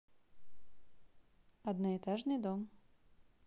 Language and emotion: Russian, neutral